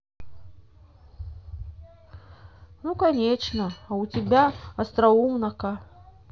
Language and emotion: Russian, sad